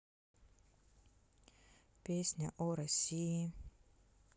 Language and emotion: Russian, neutral